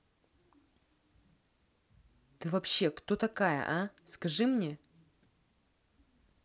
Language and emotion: Russian, angry